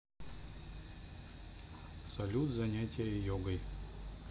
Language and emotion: Russian, neutral